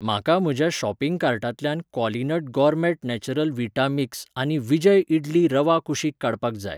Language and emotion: Goan Konkani, neutral